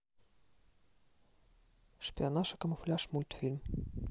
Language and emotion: Russian, neutral